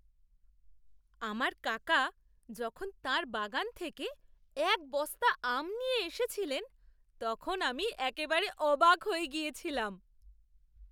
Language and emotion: Bengali, surprised